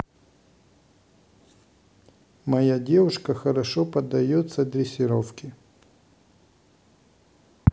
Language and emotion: Russian, neutral